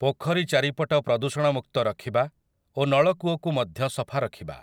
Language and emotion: Odia, neutral